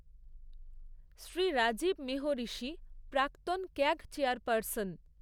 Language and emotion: Bengali, neutral